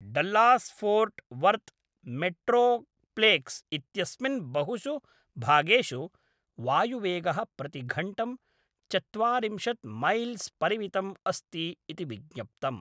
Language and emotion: Sanskrit, neutral